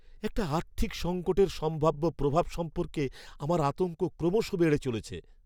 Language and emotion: Bengali, fearful